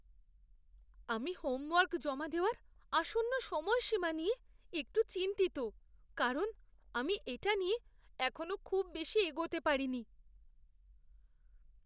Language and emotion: Bengali, fearful